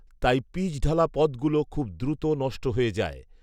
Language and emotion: Bengali, neutral